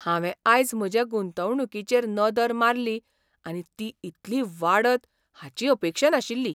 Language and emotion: Goan Konkani, surprised